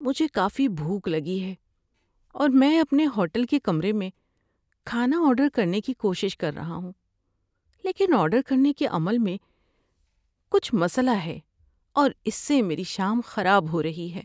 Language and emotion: Urdu, sad